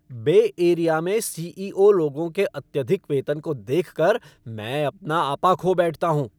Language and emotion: Hindi, angry